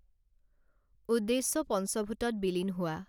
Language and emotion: Assamese, neutral